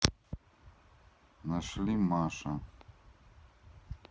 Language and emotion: Russian, neutral